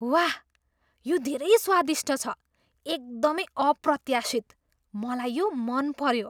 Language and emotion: Nepali, surprised